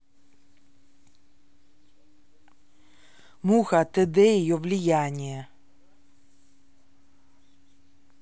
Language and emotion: Russian, neutral